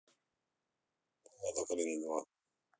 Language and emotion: Russian, angry